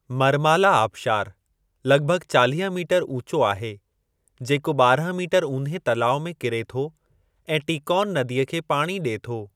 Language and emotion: Sindhi, neutral